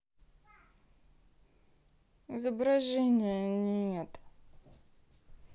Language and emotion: Russian, sad